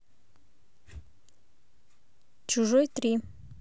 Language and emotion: Russian, neutral